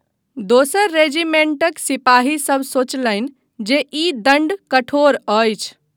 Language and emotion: Maithili, neutral